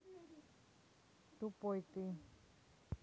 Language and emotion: Russian, neutral